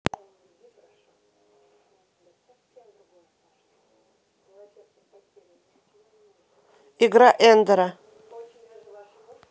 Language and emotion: Russian, neutral